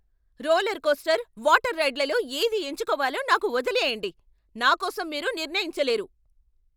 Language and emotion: Telugu, angry